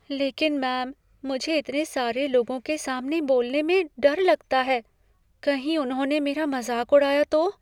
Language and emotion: Hindi, fearful